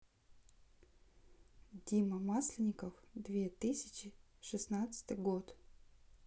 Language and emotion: Russian, neutral